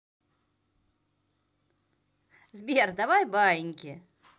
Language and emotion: Russian, positive